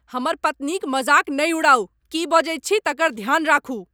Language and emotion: Maithili, angry